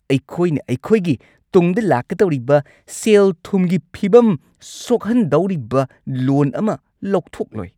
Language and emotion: Manipuri, angry